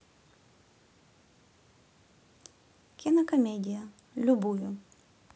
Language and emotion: Russian, neutral